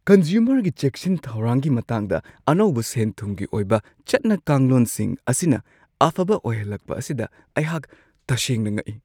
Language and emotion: Manipuri, surprised